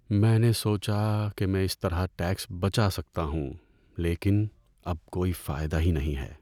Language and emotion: Urdu, sad